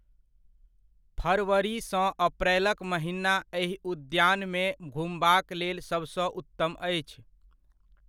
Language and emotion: Maithili, neutral